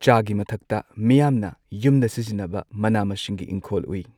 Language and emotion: Manipuri, neutral